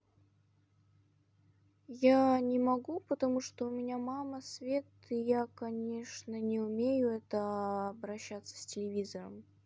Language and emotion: Russian, sad